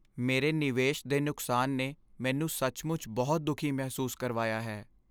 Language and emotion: Punjabi, sad